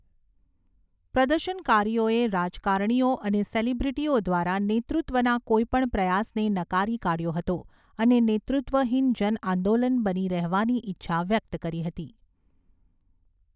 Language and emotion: Gujarati, neutral